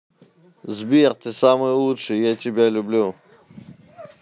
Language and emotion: Russian, neutral